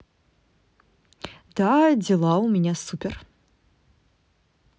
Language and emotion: Russian, positive